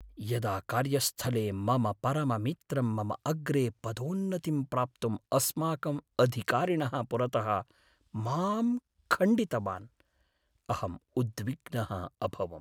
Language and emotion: Sanskrit, sad